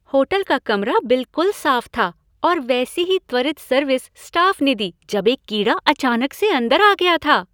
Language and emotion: Hindi, happy